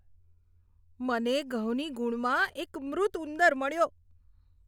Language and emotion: Gujarati, disgusted